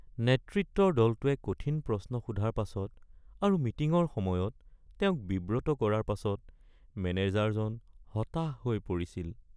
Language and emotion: Assamese, sad